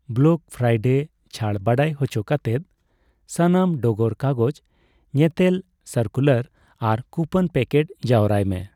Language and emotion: Santali, neutral